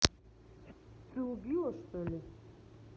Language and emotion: Russian, neutral